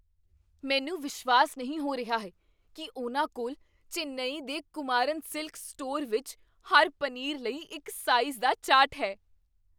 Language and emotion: Punjabi, surprised